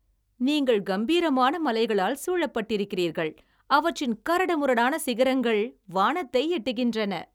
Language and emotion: Tamil, happy